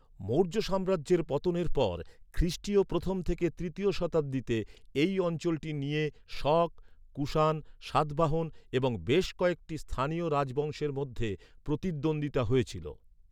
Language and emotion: Bengali, neutral